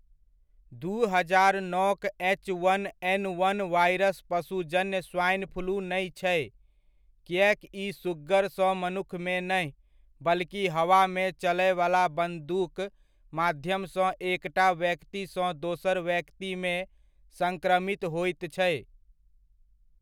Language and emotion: Maithili, neutral